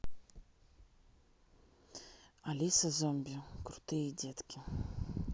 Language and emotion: Russian, neutral